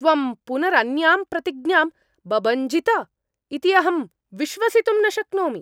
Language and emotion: Sanskrit, angry